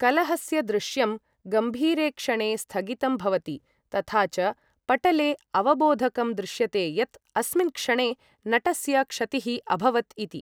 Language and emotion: Sanskrit, neutral